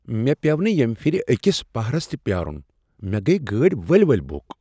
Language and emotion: Kashmiri, surprised